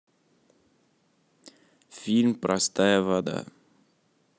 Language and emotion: Russian, neutral